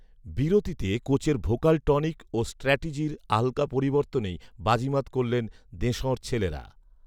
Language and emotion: Bengali, neutral